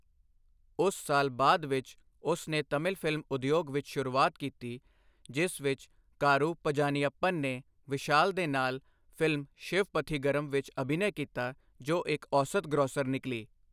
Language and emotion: Punjabi, neutral